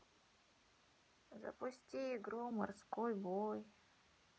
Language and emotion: Russian, sad